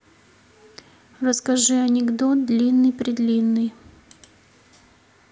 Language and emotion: Russian, neutral